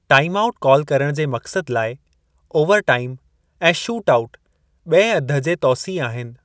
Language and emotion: Sindhi, neutral